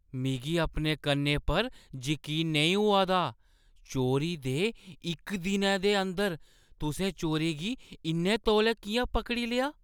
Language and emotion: Dogri, surprised